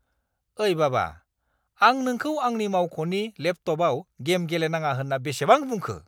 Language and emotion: Bodo, angry